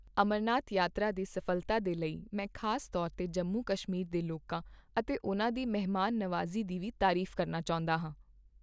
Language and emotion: Punjabi, neutral